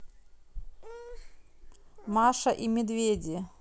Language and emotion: Russian, neutral